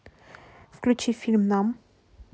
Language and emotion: Russian, neutral